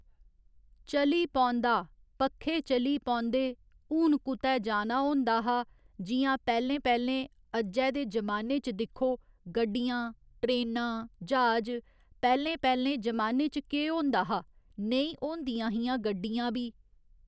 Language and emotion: Dogri, neutral